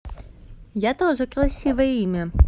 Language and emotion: Russian, positive